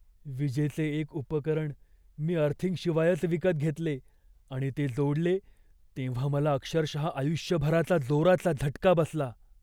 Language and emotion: Marathi, fearful